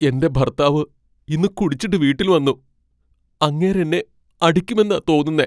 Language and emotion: Malayalam, fearful